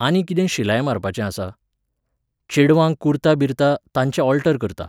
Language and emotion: Goan Konkani, neutral